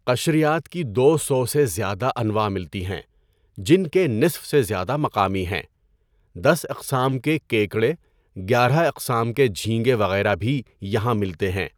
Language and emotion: Urdu, neutral